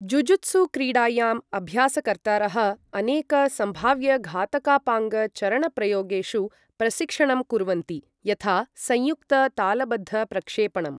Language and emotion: Sanskrit, neutral